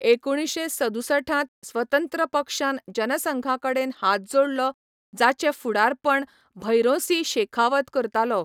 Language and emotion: Goan Konkani, neutral